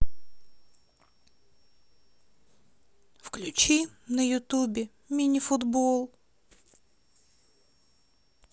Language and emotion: Russian, sad